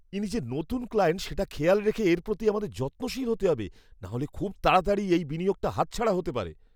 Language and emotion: Bengali, fearful